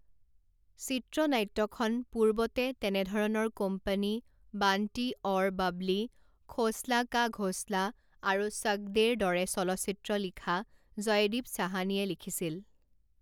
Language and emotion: Assamese, neutral